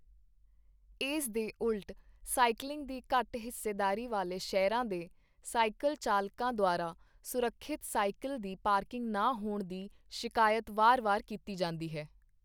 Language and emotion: Punjabi, neutral